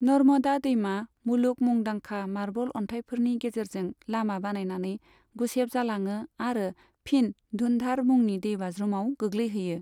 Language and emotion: Bodo, neutral